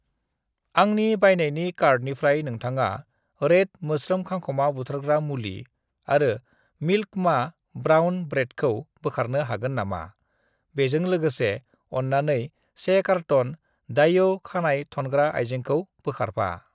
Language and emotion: Bodo, neutral